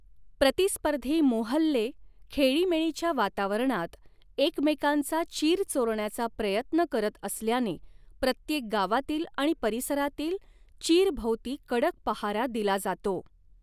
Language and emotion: Marathi, neutral